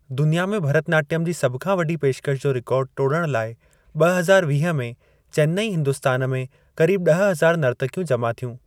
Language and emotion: Sindhi, neutral